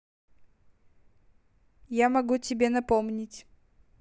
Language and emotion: Russian, neutral